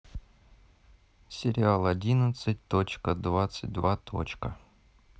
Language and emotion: Russian, neutral